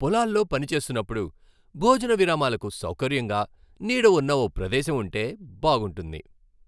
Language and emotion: Telugu, happy